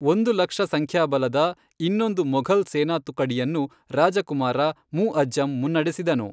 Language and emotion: Kannada, neutral